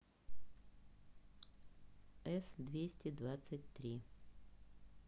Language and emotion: Russian, neutral